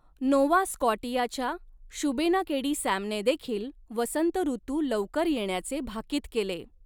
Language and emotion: Marathi, neutral